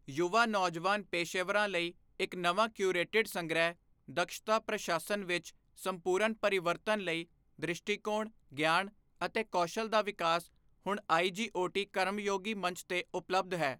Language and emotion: Punjabi, neutral